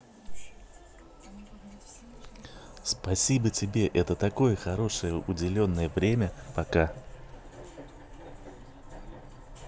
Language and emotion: Russian, positive